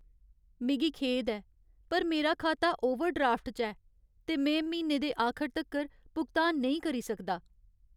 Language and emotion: Dogri, sad